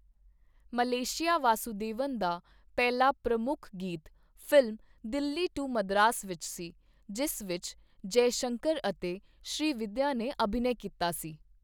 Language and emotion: Punjabi, neutral